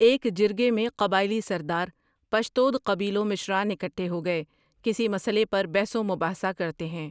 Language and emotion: Urdu, neutral